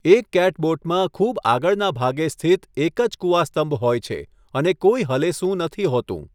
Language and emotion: Gujarati, neutral